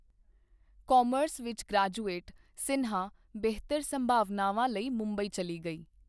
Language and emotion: Punjabi, neutral